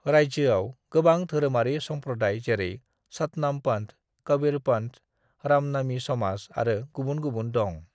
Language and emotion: Bodo, neutral